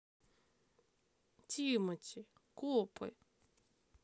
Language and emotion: Russian, sad